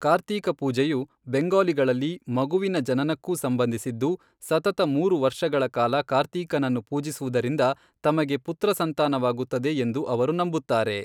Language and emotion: Kannada, neutral